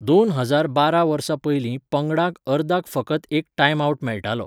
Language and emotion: Goan Konkani, neutral